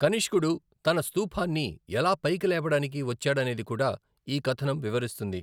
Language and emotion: Telugu, neutral